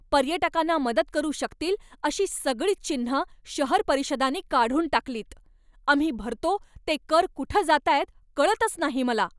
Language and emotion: Marathi, angry